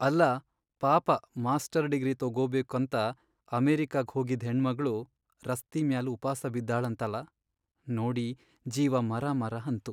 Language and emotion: Kannada, sad